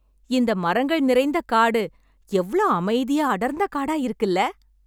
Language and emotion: Tamil, happy